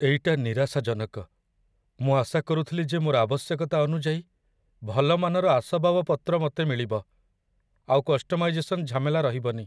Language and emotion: Odia, sad